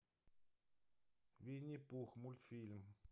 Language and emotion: Russian, neutral